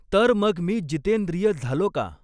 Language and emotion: Marathi, neutral